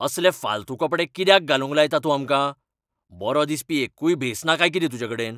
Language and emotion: Goan Konkani, angry